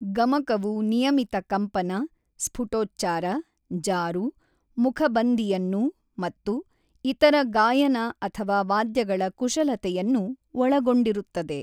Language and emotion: Kannada, neutral